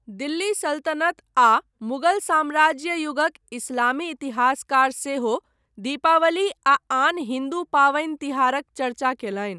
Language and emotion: Maithili, neutral